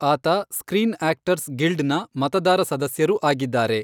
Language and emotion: Kannada, neutral